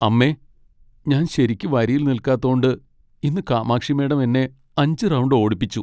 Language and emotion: Malayalam, sad